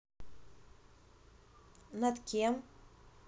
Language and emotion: Russian, neutral